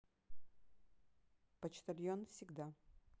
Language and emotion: Russian, neutral